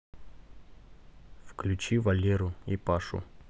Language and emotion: Russian, neutral